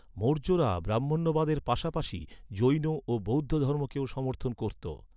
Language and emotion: Bengali, neutral